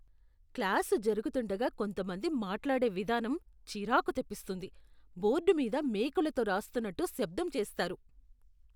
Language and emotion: Telugu, disgusted